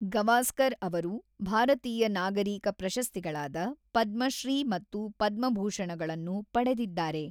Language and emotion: Kannada, neutral